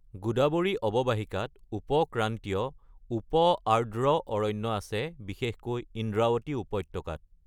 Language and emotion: Assamese, neutral